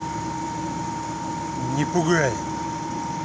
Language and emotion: Russian, angry